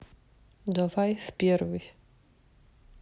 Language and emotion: Russian, sad